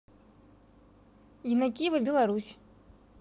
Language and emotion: Russian, neutral